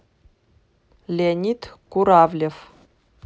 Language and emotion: Russian, neutral